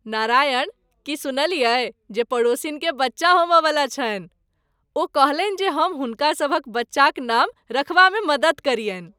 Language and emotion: Maithili, happy